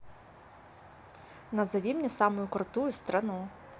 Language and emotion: Russian, neutral